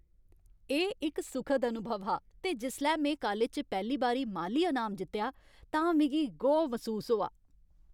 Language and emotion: Dogri, happy